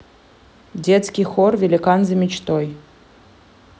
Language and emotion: Russian, neutral